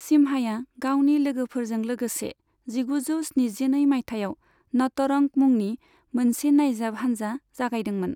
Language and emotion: Bodo, neutral